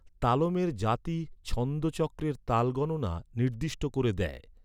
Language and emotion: Bengali, neutral